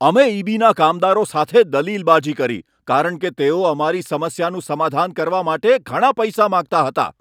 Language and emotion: Gujarati, angry